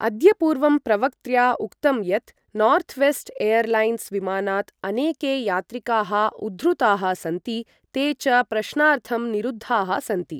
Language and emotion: Sanskrit, neutral